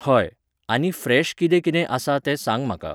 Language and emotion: Goan Konkani, neutral